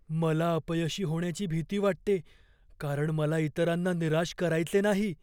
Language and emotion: Marathi, fearful